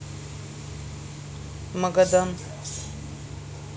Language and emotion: Russian, neutral